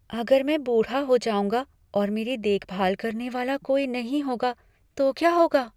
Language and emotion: Hindi, fearful